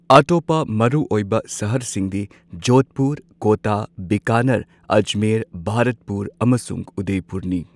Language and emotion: Manipuri, neutral